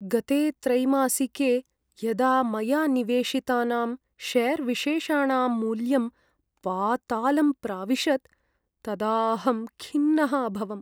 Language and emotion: Sanskrit, sad